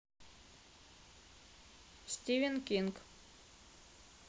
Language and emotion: Russian, neutral